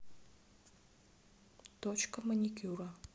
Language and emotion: Russian, neutral